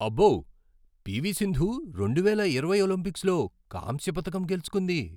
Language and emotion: Telugu, surprised